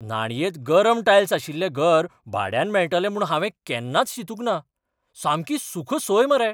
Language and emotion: Goan Konkani, surprised